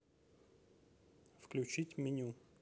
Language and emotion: Russian, neutral